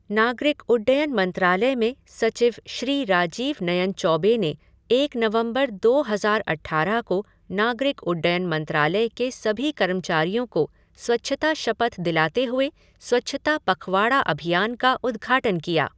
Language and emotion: Hindi, neutral